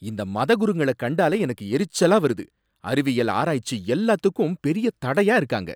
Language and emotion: Tamil, angry